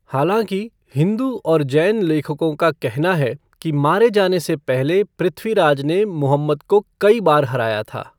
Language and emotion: Hindi, neutral